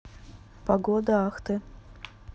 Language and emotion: Russian, neutral